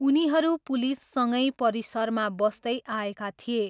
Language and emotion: Nepali, neutral